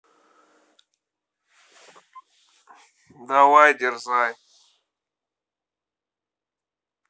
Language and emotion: Russian, neutral